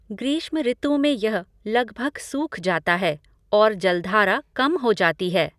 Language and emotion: Hindi, neutral